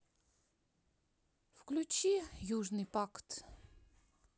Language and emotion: Russian, sad